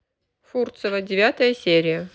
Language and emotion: Russian, neutral